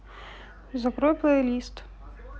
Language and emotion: Russian, neutral